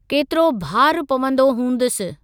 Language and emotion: Sindhi, neutral